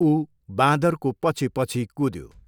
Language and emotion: Nepali, neutral